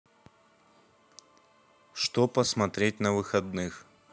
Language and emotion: Russian, neutral